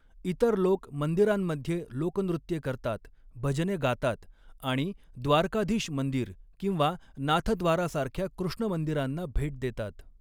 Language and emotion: Marathi, neutral